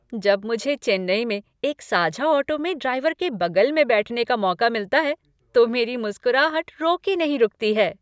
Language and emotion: Hindi, happy